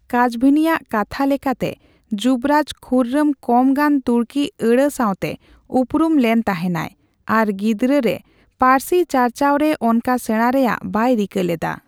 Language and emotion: Santali, neutral